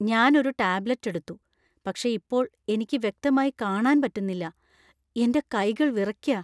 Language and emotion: Malayalam, fearful